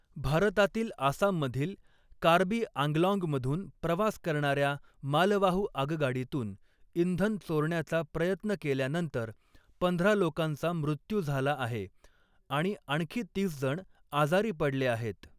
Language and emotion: Marathi, neutral